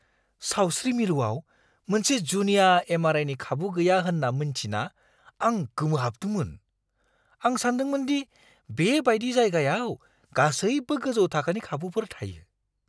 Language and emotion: Bodo, surprised